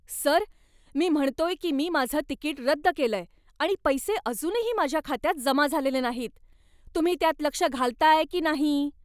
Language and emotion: Marathi, angry